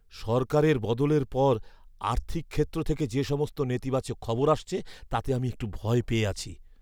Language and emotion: Bengali, fearful